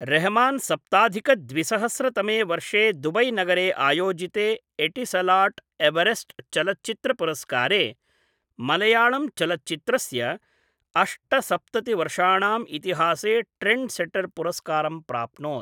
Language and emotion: Sanskrit, neutral